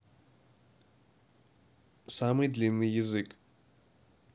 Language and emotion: Russian, neutral